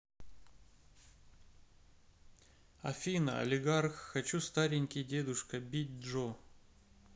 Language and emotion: Russian, neutral